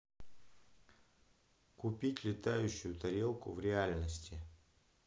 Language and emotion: Russian, neutral